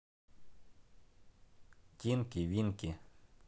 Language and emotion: Russian, neutral